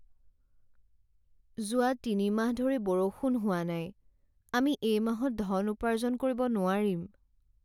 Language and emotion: Assamese, sad